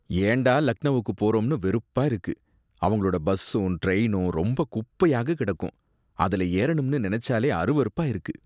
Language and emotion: Tamil, disgusted